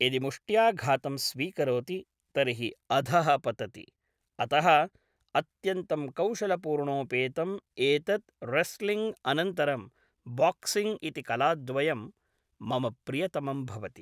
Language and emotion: Sanskrit, neutral